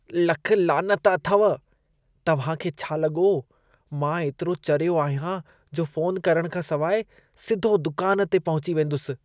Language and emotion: Sindhi, disgusted